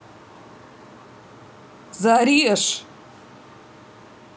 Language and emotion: Russian, angry